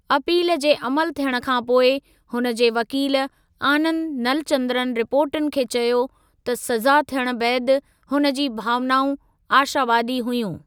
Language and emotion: Sindhi, neutral